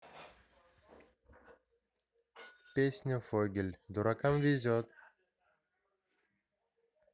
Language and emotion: Russian, neutral